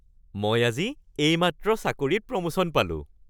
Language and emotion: Assamese, happy